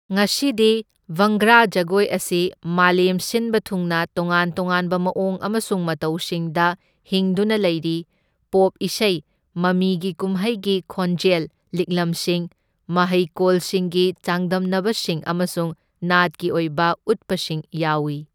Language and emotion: Manipuri, neutral